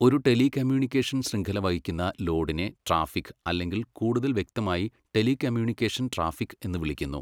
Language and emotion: Malayalam, neutral